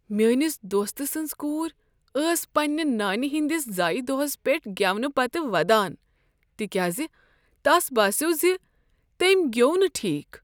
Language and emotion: Kashmiri, sad